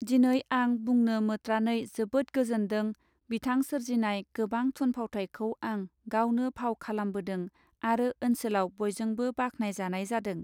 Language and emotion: Bodo, neutral